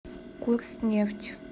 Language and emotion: Russian, neutral